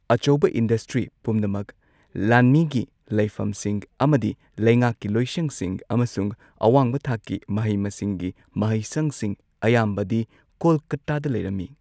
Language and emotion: Manipuri, neutral